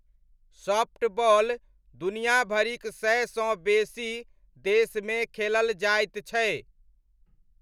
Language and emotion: Maithili, neutral